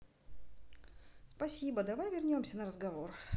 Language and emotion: Russian, neutral